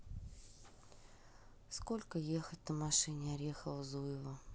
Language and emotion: Russian, neutral